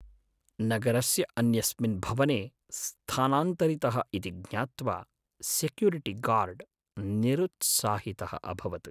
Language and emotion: Sanskrit, sad